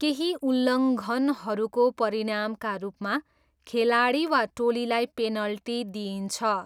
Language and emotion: Nepali, neutral